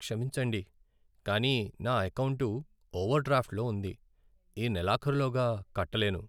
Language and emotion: Telugu, sad